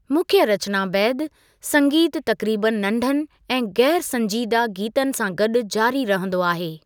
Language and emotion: Sindhi, neutral